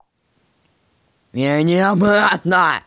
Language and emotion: Russian, angry